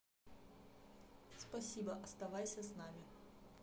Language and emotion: Russian, neutral